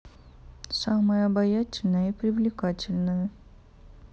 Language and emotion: Russian, neutral